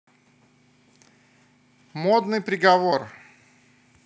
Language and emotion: Russian, positive